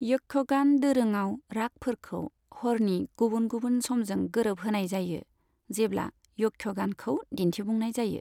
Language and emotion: Bodo, neutral